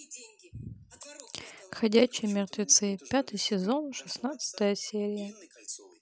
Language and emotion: Russian, neutral